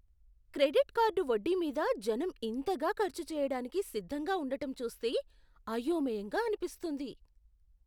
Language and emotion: Telugu, surprised